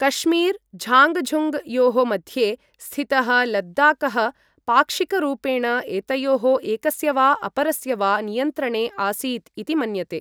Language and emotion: Sanskrit, neutral